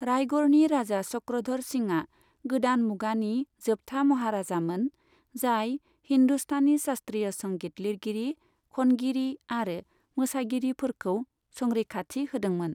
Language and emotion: Bodo, neutral